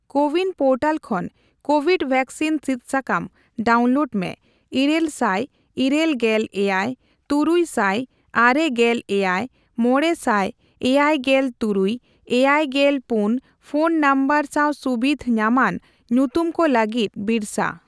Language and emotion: Santali, neutral